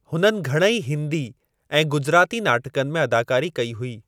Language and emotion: Sindhi, neutral